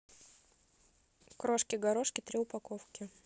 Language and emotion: Russian, neutral